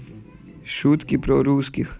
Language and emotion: Russian, neutral